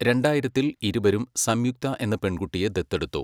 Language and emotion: Malayalam, neutral